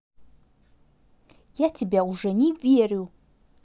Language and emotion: Russian, angry